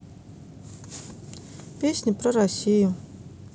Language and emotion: Russian, neutral